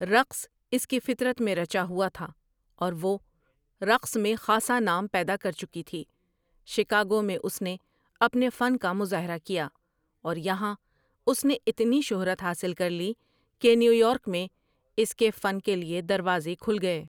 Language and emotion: Urdu, neutral